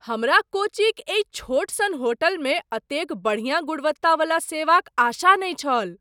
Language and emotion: Maithili, surprised